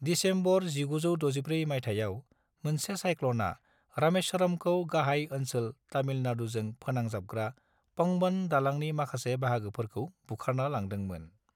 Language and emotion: Bodo, neutral